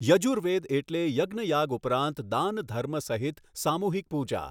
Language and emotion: Gujarati, neutral